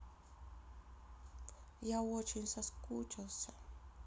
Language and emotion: Russian, sad